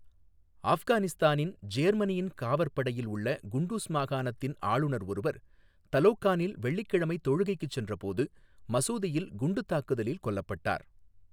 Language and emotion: Tamil, neutral